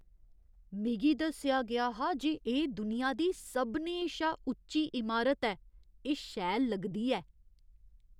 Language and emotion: Dogri, surprised